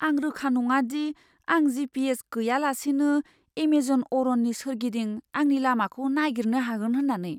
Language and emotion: Bodo, fearful